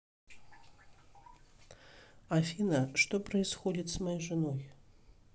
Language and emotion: Russian, neutral